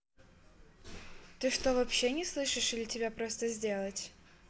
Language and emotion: Russian, neutral